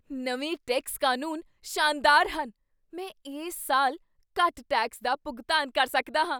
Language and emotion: Punjabi, surprised